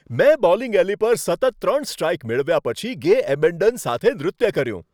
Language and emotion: Gujarati, happy